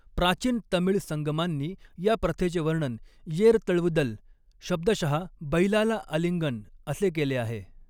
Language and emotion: Marathi, neutral